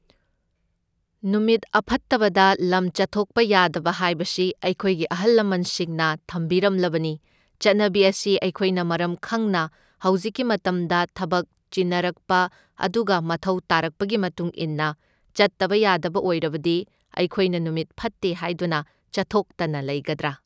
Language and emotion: Manipuri, neutral